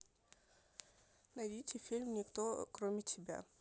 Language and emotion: Russian, neutral